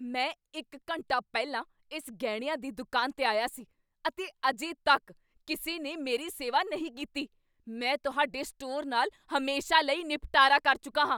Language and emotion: Punjabi, angry